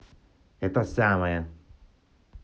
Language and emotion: Russian, angry